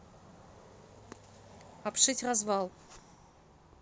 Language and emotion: Russian, neutral